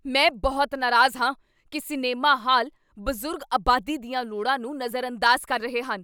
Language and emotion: Punjabi, angry